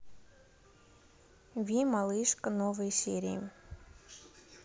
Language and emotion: Russian, neutral